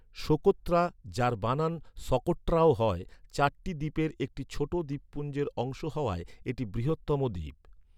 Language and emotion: Bengali, neutral